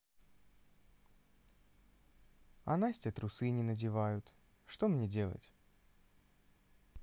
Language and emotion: Russian, sad